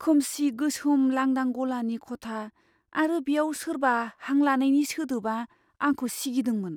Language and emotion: Bodo, fearful